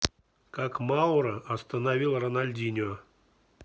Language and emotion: Russian, neutral